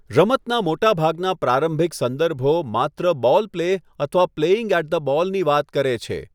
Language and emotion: Gujarati, neutral